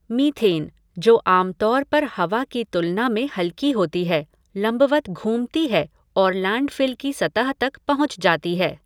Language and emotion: Hindi, neutral